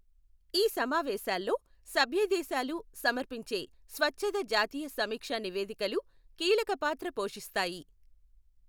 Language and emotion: Telugu, neutral